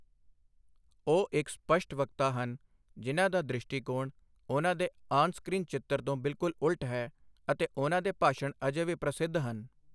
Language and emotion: Punjabi, neutral